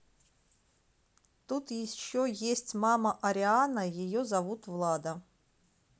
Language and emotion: Russian, neutral